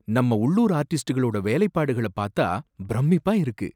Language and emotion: Tamil, surprised